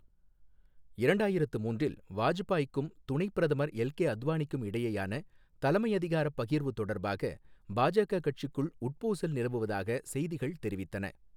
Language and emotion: Tamil, neutral